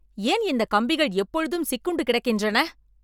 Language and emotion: Tamil, angry